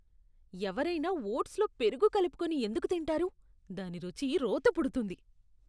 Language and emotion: Telugu, disgusted